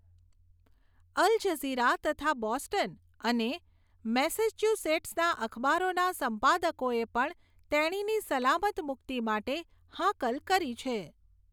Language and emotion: Gujarati, neutral